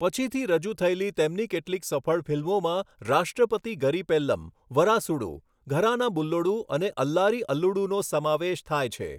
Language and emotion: Gujarati, neutral